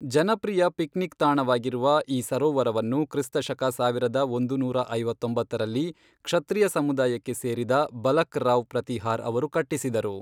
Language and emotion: Kannada, neutral